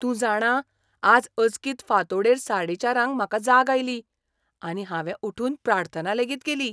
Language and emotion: Goan Konkani, surprised